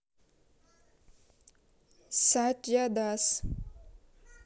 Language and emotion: Russian, neutral